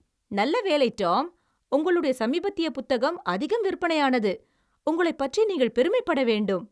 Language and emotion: Tamil, happy